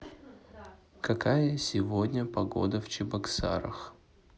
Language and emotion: Russian, neutral